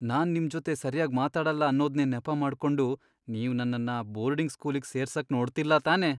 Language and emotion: Kannada, fearful